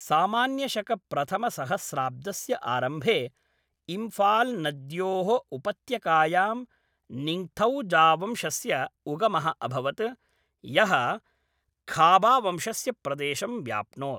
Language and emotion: Sanskrit, neutral